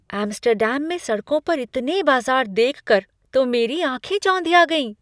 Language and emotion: Hindi, surprised